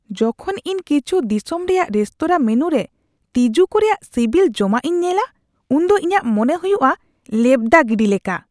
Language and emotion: Santali, disgusted